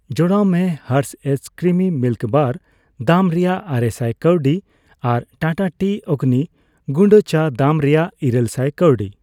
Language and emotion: Santali, neutral